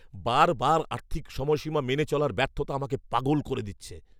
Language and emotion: Bengali, angry